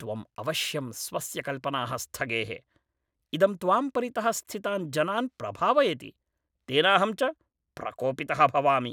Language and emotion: Sanskrit, angry